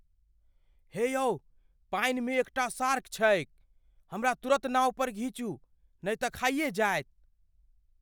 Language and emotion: Maithili, fearful